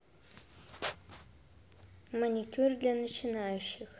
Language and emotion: Russian, neutral